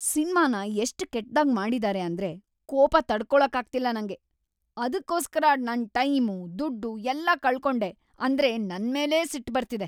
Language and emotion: Kannada, angry